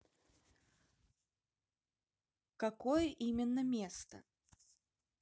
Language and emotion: Russian, neutral